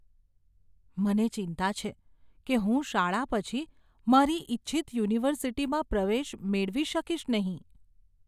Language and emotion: Gujarati, fearful